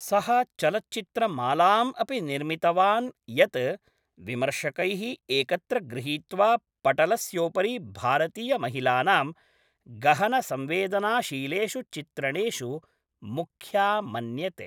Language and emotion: Sanskrit, neutral